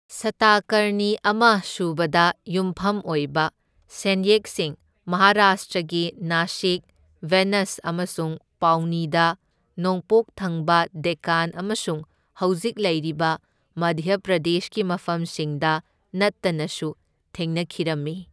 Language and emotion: Manipuri, neutral